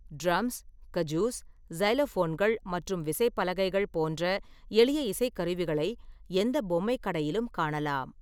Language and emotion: Tamil, neutral